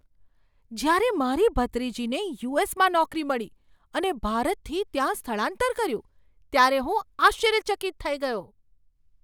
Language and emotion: Gujarati, surprised